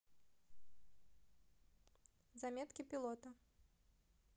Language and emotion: Russian, neutral